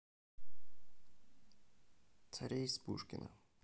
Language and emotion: Russian, neutral